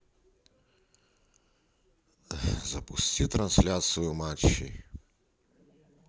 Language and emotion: Russian, sad